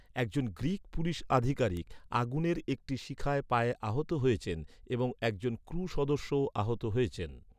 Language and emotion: Bengali, neutral